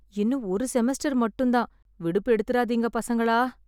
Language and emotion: Tamil, sad